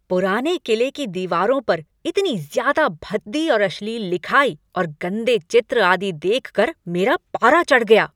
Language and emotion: Hindi, angry